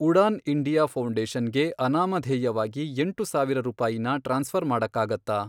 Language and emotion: Kannada, neutral